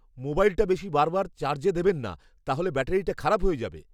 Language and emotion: Bengali, fearful